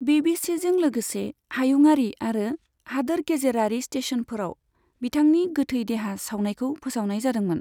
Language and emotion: Bodo, neutral